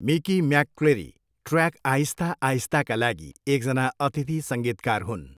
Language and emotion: Nepali, neutral